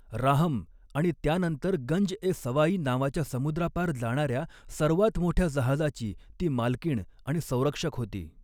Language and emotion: Marathi, neutral